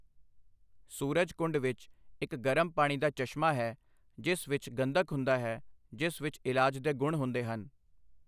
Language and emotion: Punjabi, neutral